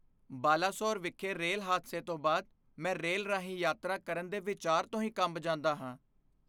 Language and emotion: Punjabi, fearful